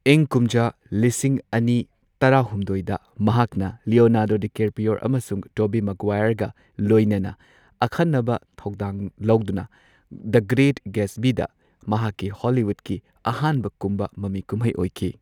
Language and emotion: Manipuri, neutral